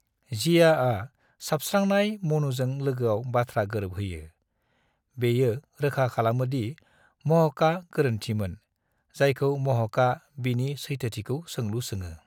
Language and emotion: Bodo, neutral